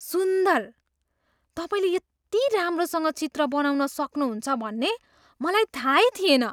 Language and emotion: Nepali, surprised